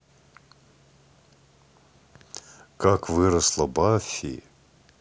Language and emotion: Russian, neutral